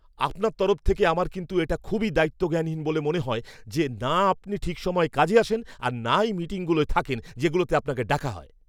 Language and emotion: Bengali, angry